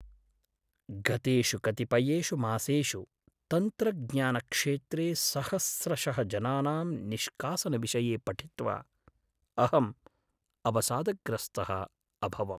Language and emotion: Sanskrit, sad